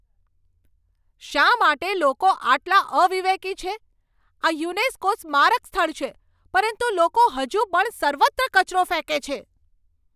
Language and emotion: Gujarati, angry